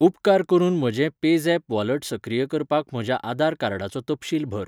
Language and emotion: Goan Konkani, neutral